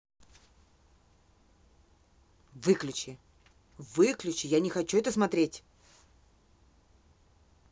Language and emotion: Russian, angry